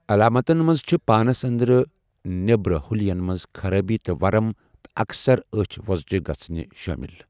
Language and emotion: Kashmiri, neutral